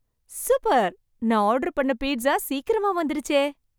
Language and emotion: Tamil, happy